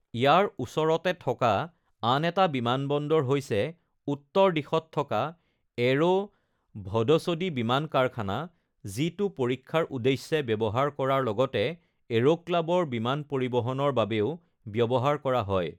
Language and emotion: Assamese, neutral